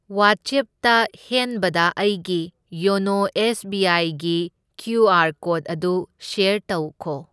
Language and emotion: Manipuri, neutral